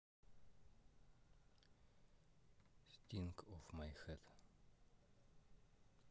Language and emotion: Russian, neutral